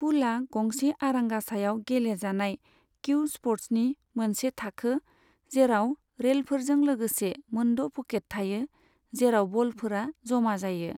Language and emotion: Bodo, neutral